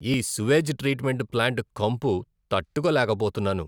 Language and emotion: Telugu, disgusted